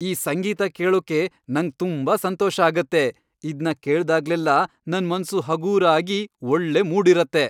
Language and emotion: Kannada, happy